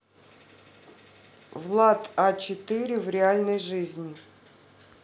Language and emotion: Russian, neutral